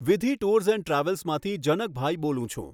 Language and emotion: Gujarati, neutral